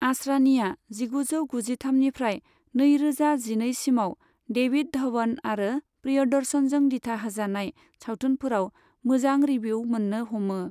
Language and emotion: Bodo, neutral